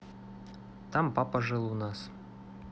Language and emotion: Russian, neutral